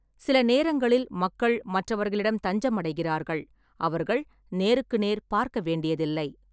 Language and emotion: Tamil, neutral